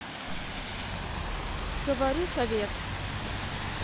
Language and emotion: Russian, neutral